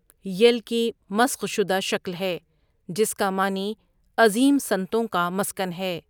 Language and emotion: Urdu, neutral